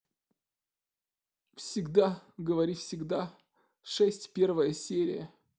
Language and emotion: Russian, sad